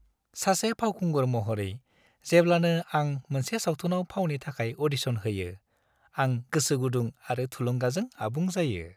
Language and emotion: Bodo, happy